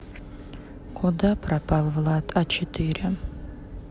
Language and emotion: Russian, sad